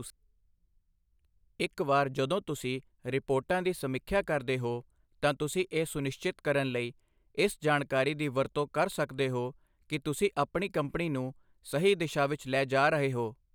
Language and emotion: Punjabi, neutral